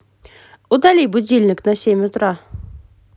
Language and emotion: Russian, positive